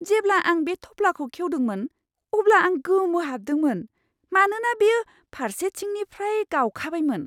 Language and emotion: Bodo, surprised